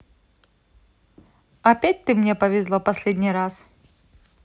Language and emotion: Russian, neutral